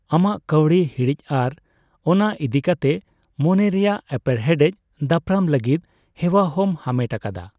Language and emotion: Santali, neutral